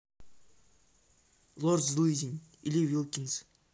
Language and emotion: Russian, neutral